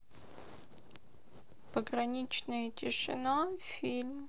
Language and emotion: Russian, sad